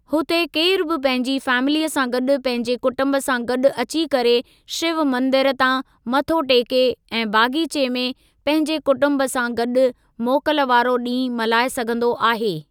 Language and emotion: Sindhi, neutral